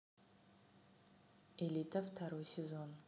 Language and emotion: Russian, neutral